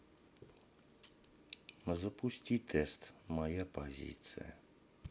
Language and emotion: Russian, sad